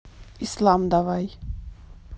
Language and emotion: Russian, neutral